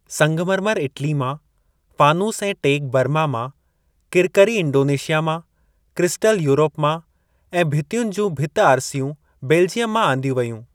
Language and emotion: Sindhi, neutral